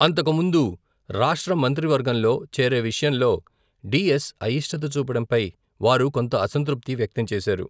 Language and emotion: Telugu, neutral